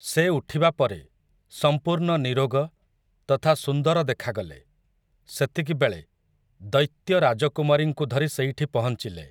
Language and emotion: Odia, neutral